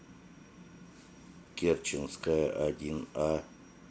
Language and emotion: Russian, neutral